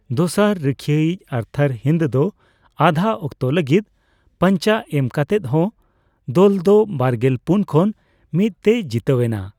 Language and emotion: Santali, neutral